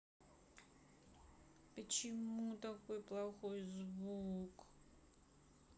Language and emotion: Russian, sad